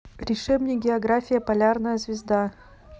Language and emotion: Russian, neutral